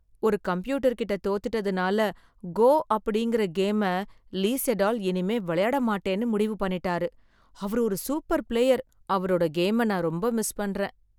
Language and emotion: Tamil, sad